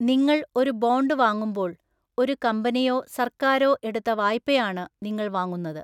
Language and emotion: Malayalam, neutral